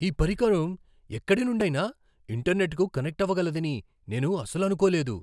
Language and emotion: Telugu, surprised